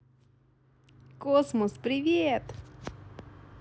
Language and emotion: Russian, positive